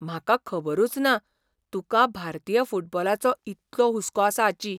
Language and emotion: Goan Konkani, surprised